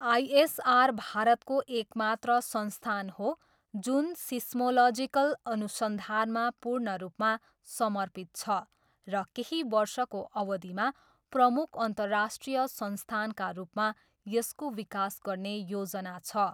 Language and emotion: Nepali, neutral